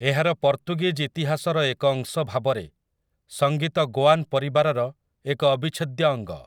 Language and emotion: Odia, neutral